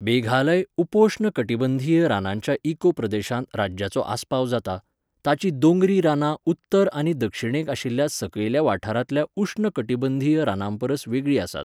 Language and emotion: Goan Konkani, neutral